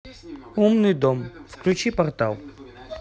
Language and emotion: Russian, neutral